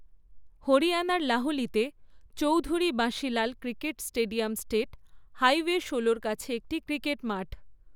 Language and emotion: Bengali, neutral